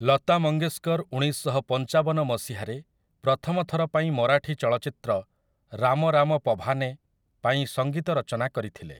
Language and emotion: Odia, neutral